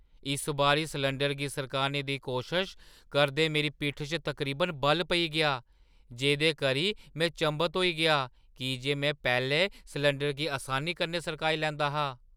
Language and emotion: Dogri, surprised